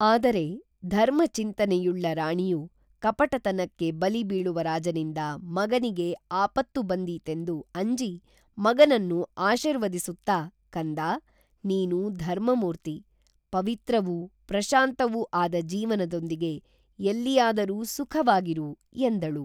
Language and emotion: Kannada, neutral